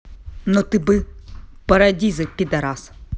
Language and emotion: Russian, angry